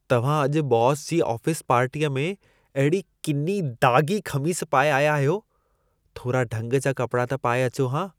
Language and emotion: Sindhi, disgusted